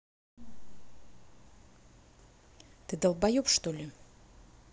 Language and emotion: Russian, angry